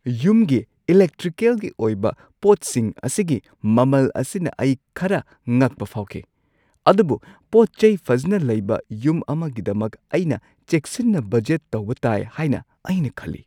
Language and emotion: Manipuri, surprised